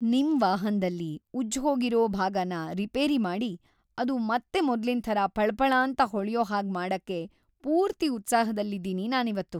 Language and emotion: Kannada, happy